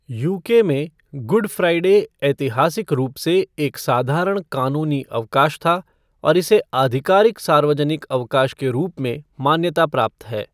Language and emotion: Hindi, neutral